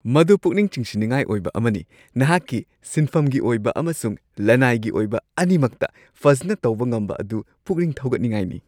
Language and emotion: Manipuri, happy